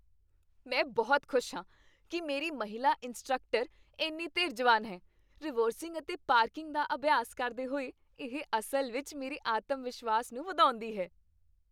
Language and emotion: Punjabi, happy